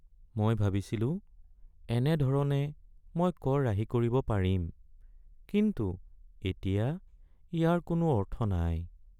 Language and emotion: Assamese, sad